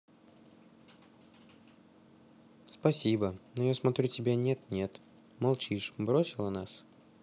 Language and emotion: Russian, sad